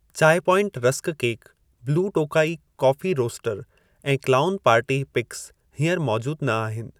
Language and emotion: Sindhi, neutral